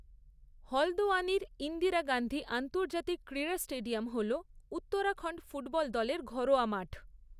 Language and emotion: Bengali, neutral